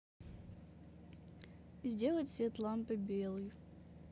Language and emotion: Russian, neutral